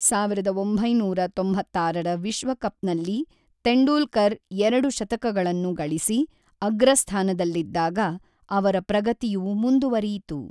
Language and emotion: Kannada, neutral